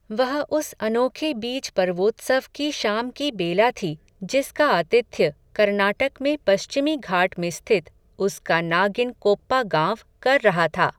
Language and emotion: Hindi, neutral